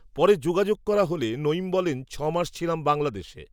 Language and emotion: Bengali, neutral